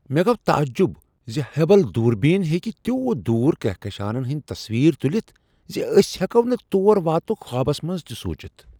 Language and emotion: Kashmiri, surprised